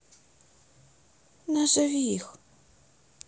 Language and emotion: Russian, sad